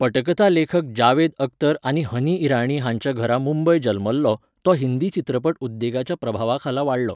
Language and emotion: Goan Konkani, neutral